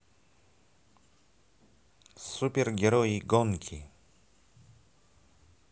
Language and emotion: Russian, positive